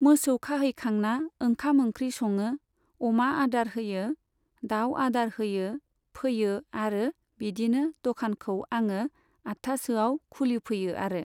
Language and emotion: Bodo, neutral